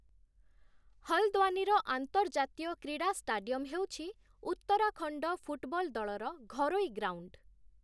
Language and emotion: Odia, neutral